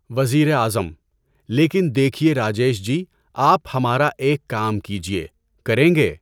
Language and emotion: Urdu, neutral